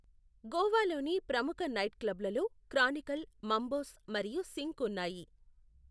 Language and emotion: Telugu, neutral